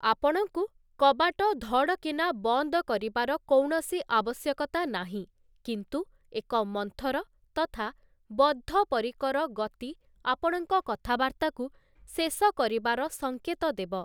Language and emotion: Odia, neutral